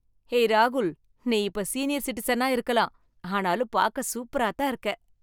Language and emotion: Tamil, happy